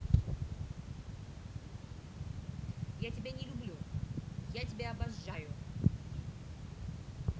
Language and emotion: Russian, neutral